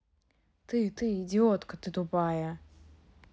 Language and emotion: Russian, angry